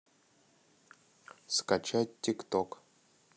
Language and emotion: Russian, neutral